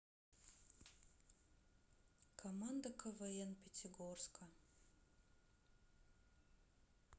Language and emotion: Russian, sad